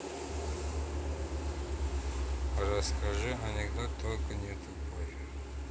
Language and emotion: Russian, neutral